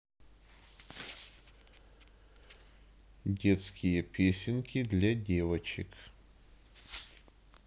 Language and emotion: Russian, neutral